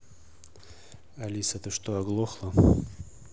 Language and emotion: Russian, neutral